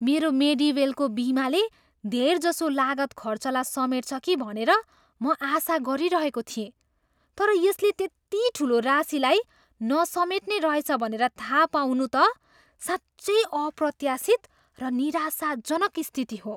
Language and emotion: Nepali, surprised